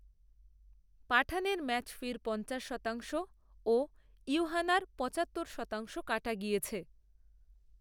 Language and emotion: Bengali, neutral